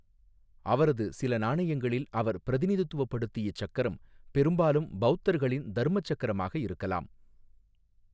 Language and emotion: Tamil, neutral